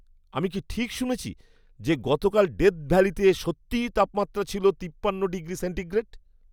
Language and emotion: Bengali, surprised